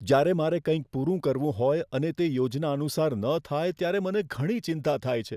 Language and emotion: Gujarati, fearful